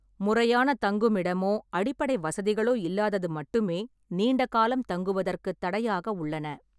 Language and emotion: Tamil, neutral